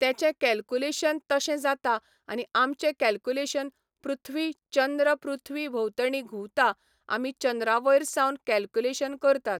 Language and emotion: Goan Konkani, neutral